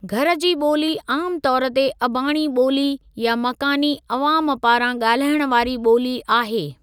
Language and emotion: Sindhi, neutral